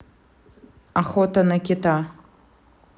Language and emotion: Russian, neutral